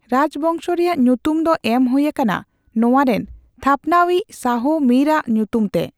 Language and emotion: Santali, neutral